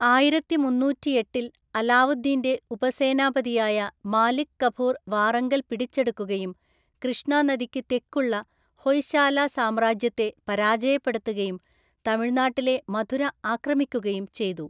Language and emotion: Malayalam, neutral